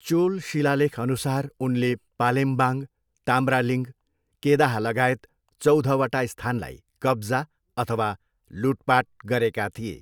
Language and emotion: Nepali, neutral